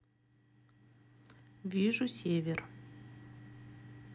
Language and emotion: Russian, neutral